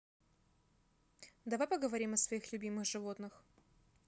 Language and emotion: Russian, neutral